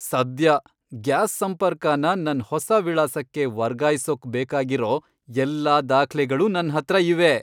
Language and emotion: Kannada, happy